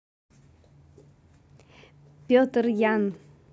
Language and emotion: Russian, neutral